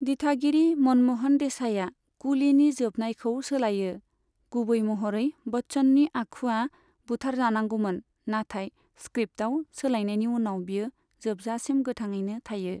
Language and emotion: Bodo, neutral